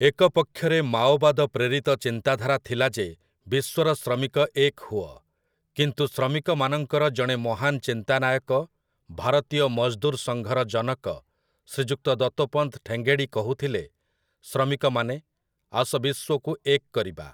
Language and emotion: Odia, neutral